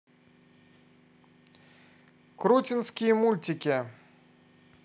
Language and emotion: Russian, positive